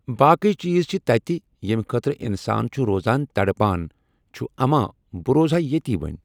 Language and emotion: Kashmiri, neutral